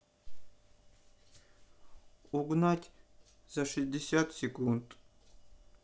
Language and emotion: Russian, sad